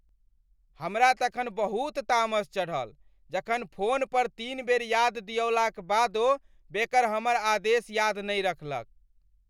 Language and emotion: Maithili, angry